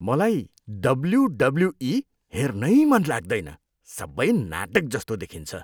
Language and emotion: Nepali, disgusted